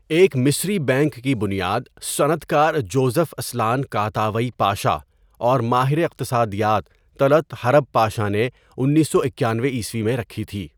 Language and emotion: Urdu, neutral